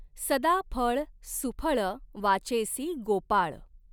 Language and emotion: Marathi, neutral